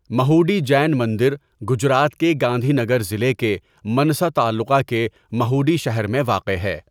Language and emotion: Urdu, neutral